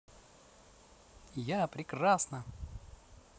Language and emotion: Russian, positive